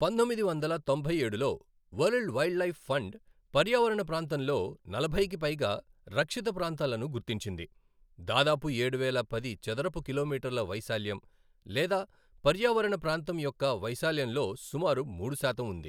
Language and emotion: Telugu, neutral